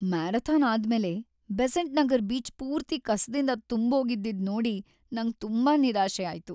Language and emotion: Kannada, sad